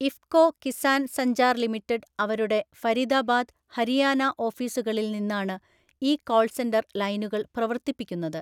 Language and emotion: Malayalam, neutral